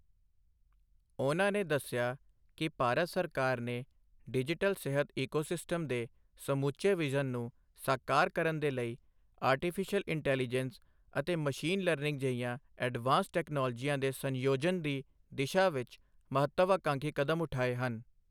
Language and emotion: Punjabi, neutral